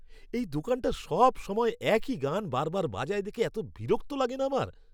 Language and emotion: Bengali, angry